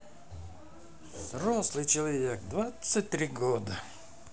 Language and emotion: Russian, neutral